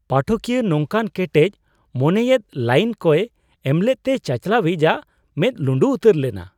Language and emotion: Santali, surprised